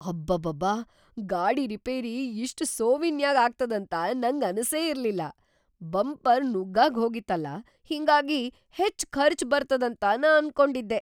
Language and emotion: Kannada, surprised